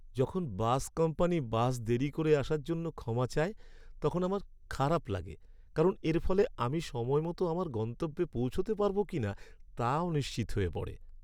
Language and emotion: Bengali, sad